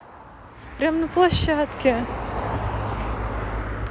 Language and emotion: Russian, positive